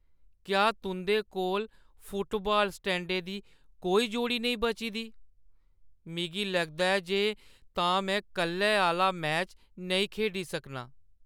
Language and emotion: Dogri, sad